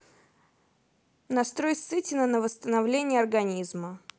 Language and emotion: Russian, neutral